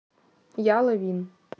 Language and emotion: Russian, neutral